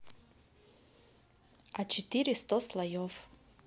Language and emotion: Russian, neutral